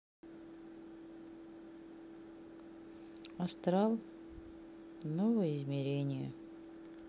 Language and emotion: Russian, sad